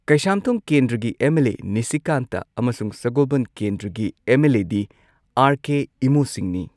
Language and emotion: Manipuri, neutral